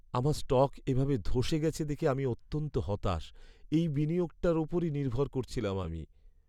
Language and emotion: Bengali, sad